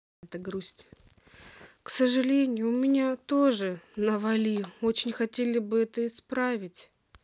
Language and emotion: Russian, sad